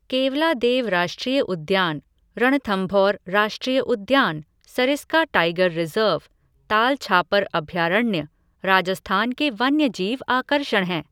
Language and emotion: Hindi, neutral